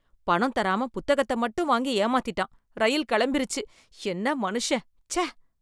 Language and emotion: Tamil, disgusted